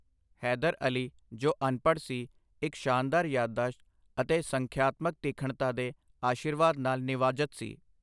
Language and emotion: Punjabi, neutral